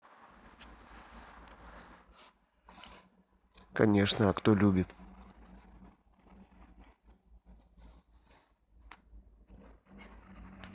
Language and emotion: Russian, neutral